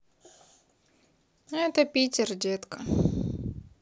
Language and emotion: Russian, sad